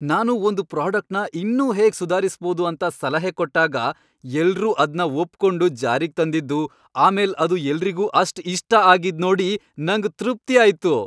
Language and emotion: Kannada, happy